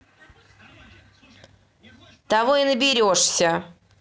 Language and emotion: Russian, angry